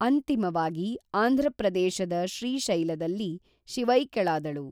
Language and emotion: Kannada, neutral